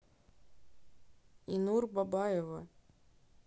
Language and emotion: Russian, neutral